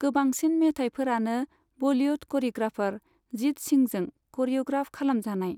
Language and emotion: Bodo, neutral